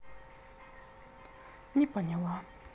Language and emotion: Russian, sad